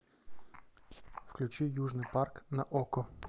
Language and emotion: Russian, neutral